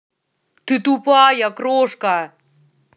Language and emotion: Russian, angry